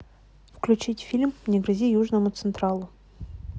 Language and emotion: Russian, neutral